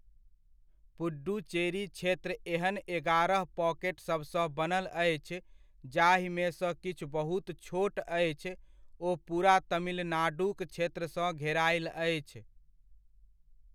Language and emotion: Maithili, neutral